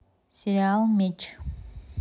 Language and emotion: Russian, neutral